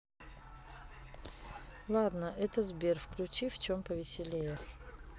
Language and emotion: Russian, neutral